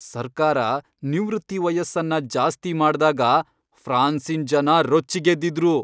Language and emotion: Kannada, angry